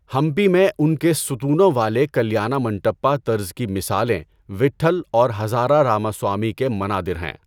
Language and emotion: Urdu, neutral